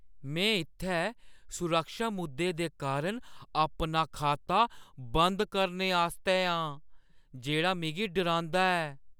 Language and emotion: Dogri, fearful